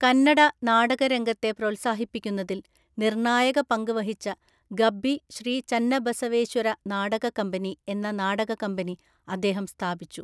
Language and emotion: Malayalam, neutral